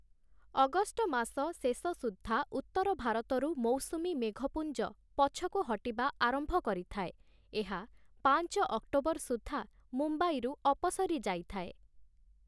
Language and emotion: Odia, neutral